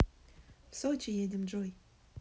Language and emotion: Russian, neutral